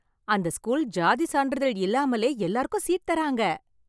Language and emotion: Tamil, happy